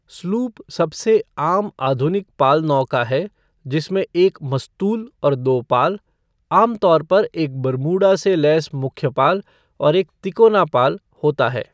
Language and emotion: Hindi, neutral